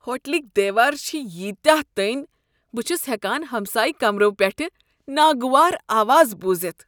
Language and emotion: Kashmiri, disgusted